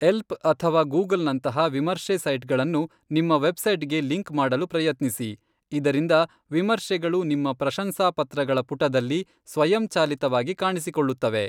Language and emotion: Kannada, neutral